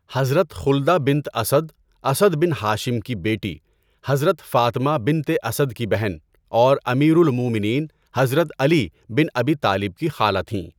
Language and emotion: Urdu, neutral